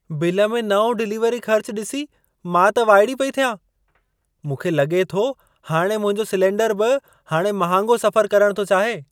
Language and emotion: Sindhi, surprised